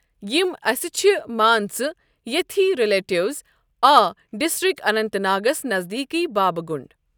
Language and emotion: Kashmiri, neutral